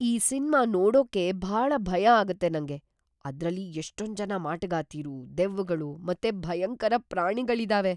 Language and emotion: Kannada, fearful